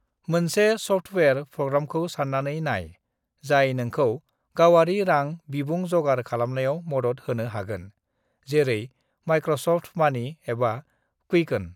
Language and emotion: Bodo, neutral